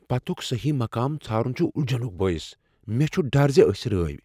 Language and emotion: Kashmiri, fearful